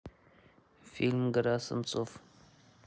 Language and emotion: Russian, neutral